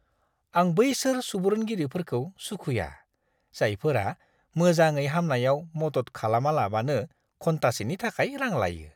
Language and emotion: Bodo, disgusted